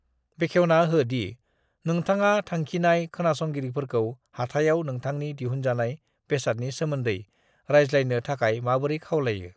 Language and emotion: Bodo, neutral